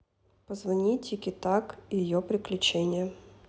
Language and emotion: Russian, neutral